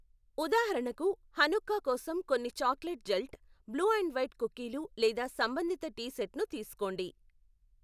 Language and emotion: Telugu, neutral